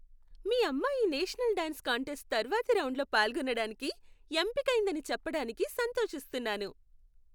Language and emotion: Telugu, happy